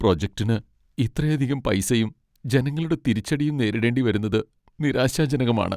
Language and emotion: Malayalam, sad